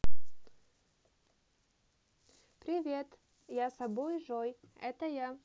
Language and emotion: Russian, positive